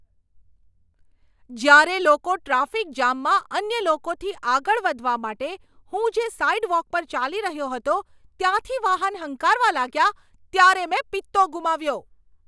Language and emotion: Gujarati, angry